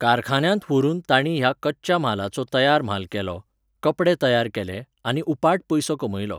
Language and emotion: Goan Konkani, neutral